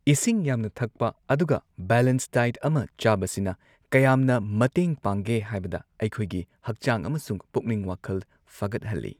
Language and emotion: Manipuri, neutral